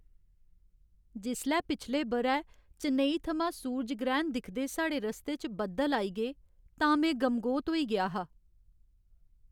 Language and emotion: Dogri, sad